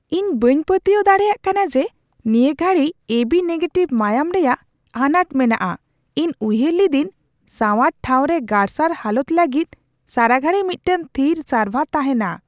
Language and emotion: Santali, surprised